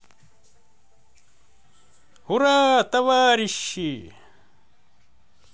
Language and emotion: Russian, positive